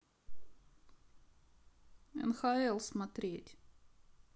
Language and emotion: Russian, neutral